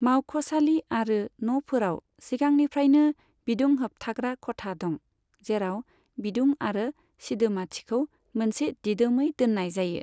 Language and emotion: Bodo, neutral